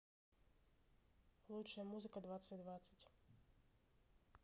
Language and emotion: Russian, neutral